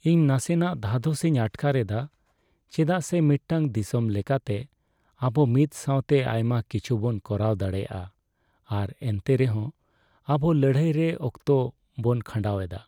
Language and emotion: Santali, sad